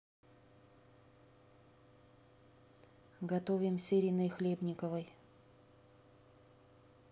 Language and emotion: Russian, neutral